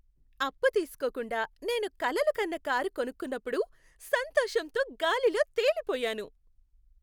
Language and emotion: Telugu, happy